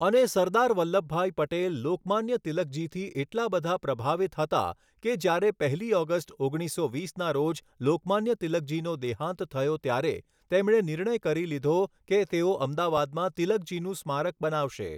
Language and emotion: Gujarati, neutral